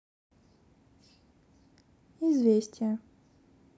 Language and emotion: Russian, neutral